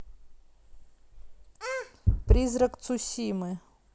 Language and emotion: Russian, neutral